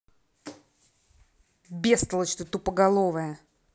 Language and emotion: Russian, angry